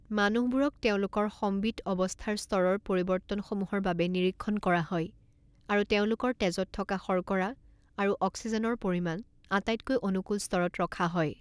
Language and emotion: Assamese, neutral